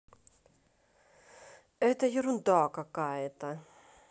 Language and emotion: Russian, angry